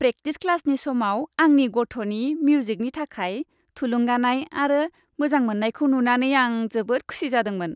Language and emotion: Bodo, happy